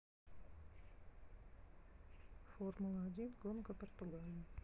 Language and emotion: Russian, neutral